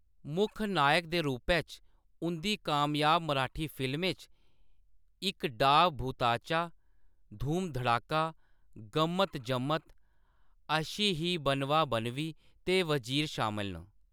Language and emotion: Dogri, neutral